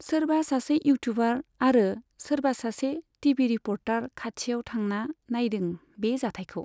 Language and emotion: Bodo, neutral